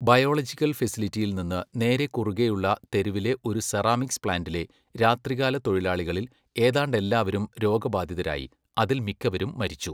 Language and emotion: Malayalam, neutral